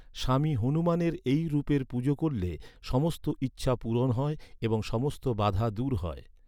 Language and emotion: Bengali, neutral